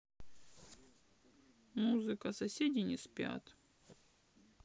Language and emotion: Russian, sad